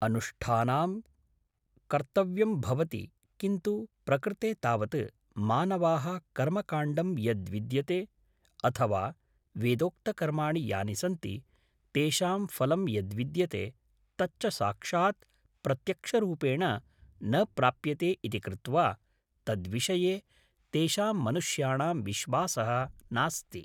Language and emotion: Sanskrit, neutral